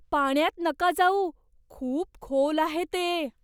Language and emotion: Marathi, fearful